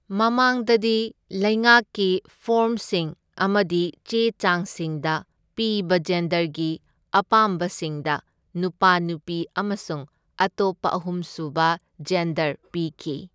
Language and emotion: Manipuri, neutral